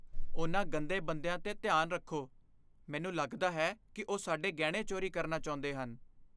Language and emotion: Punjabi, fearful